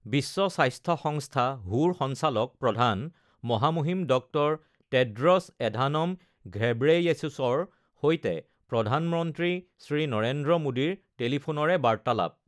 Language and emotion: Assamese, neutral